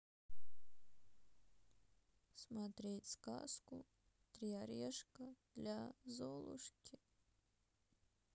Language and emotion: Russian, sad